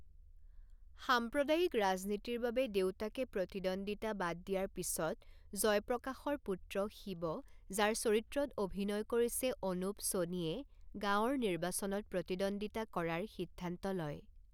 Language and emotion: Assamese, neutral